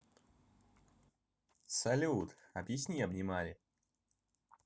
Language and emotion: Russian, positive